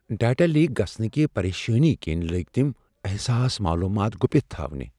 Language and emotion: Kashmiri, fearful